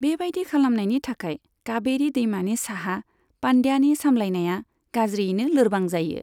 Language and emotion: Bodo, neutral